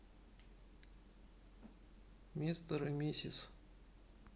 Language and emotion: Russian, neutral